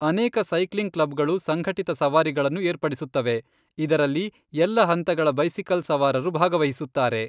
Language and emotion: Kannada, neutral